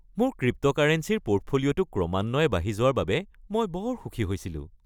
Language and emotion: Assamese, happy